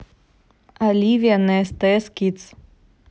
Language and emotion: Russian, neutral